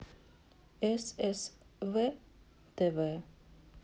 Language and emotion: Russian, neutral